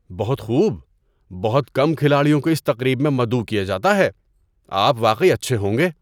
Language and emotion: Urdu, surprised